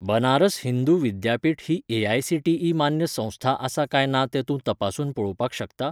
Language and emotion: Goan Konkani, neutral